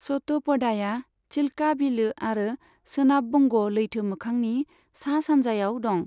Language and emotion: Bodo, neutral